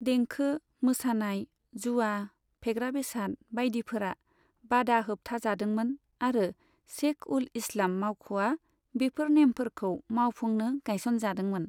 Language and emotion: Bodo, neutral